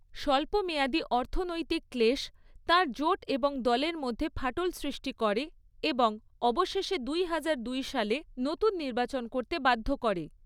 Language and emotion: Bengali, neutral